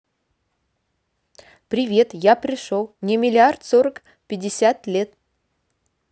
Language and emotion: Russian, neutral